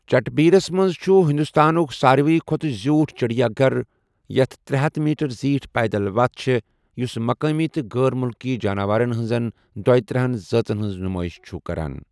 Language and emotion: Kashmiri, neutral